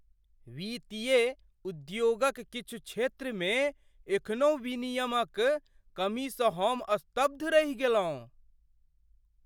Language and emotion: Maithili, surprised